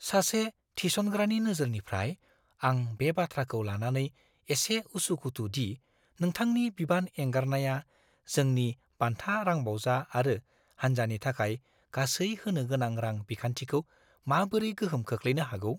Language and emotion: Bodo, fearful